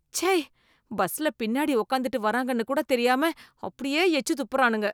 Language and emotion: Tamil, disgusted